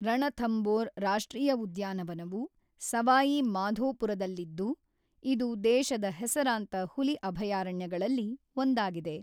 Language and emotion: Kannada, neutral